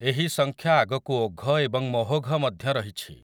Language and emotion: Odia, neutral